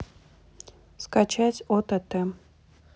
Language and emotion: Russian, neutral